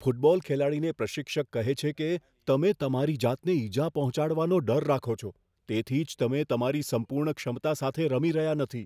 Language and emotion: Gujarati, fearful